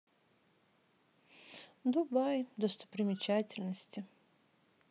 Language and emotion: Russian, sad